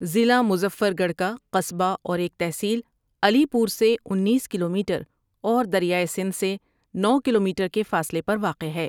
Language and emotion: Urdu, neutral